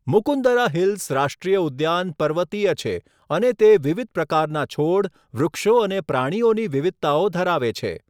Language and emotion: Gujarati, neutral